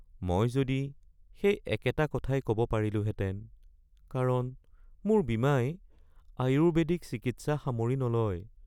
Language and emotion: Assamese, sad